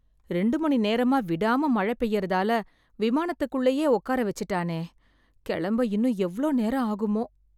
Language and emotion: Tamil, sad